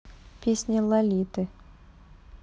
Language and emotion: Russian, neutral